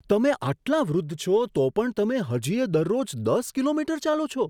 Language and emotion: Gujarati, surprised